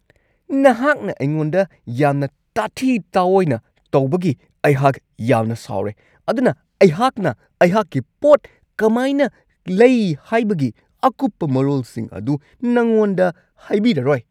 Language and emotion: Manipuri, angry